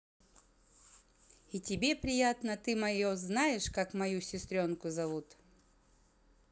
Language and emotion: Russian, positive